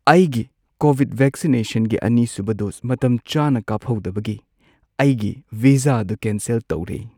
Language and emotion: Manipuri, sad